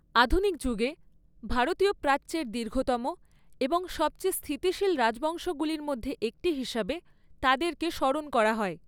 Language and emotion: Bengali, neutral